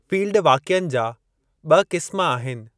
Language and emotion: Sindhi, neutral